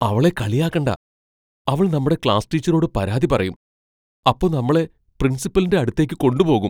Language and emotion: Malayalam, fearful